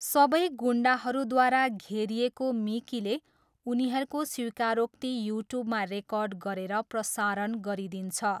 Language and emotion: Nepali, neutral